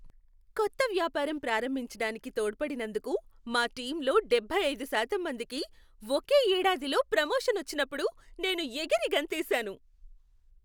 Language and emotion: Telugu, happy